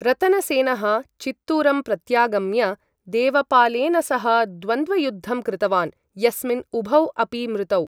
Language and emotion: Sanskrit, neutral